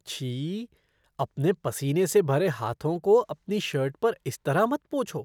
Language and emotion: Hindi, disgusted